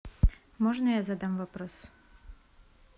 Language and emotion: Russian, neutral